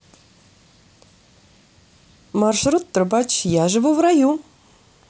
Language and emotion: Russian, positive